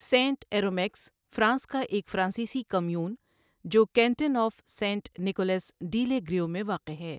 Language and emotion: Urdu, neutral